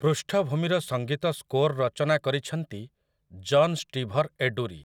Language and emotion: Odia, neutral